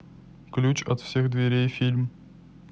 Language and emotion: Russian, neutral